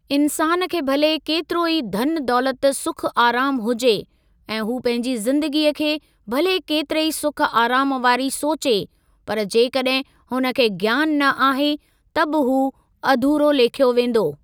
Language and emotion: Sindhi, neutral